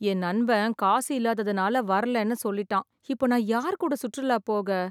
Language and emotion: Tamil, sad